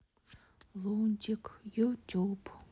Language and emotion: Russian, sad